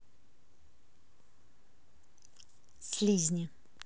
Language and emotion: Russian, neutral